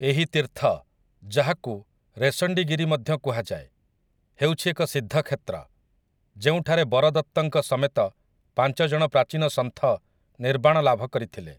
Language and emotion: Odia, neutral